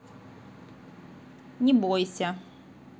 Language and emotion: Russian, neutral